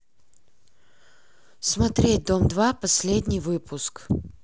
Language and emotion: Russian, neutral